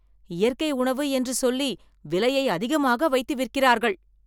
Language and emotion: Tamil, angry